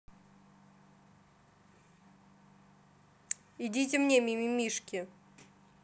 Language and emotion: Russian, neutral